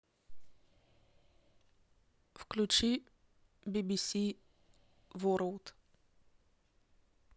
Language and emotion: Russian, neutral